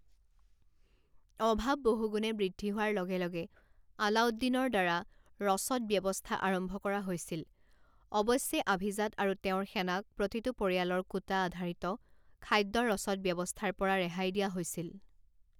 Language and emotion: Assamese, neutral